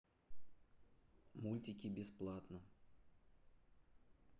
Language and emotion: Russian, neutral